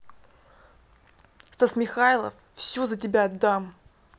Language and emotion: Russian, angry